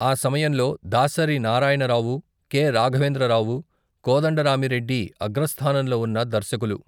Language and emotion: Telugu, neutral